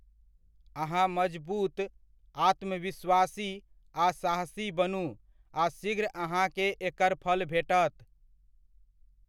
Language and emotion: Maithili, neutral